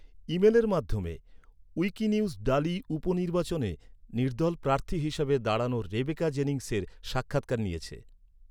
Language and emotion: Bengali, neutral